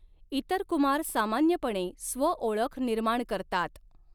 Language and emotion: Marathi, neutral